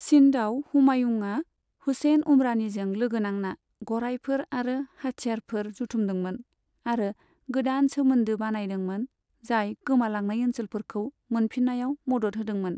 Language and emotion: Bodo, neutral